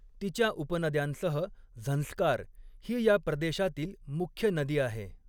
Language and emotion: Marathi, neutral